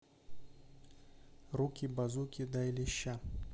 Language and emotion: Russian, neutral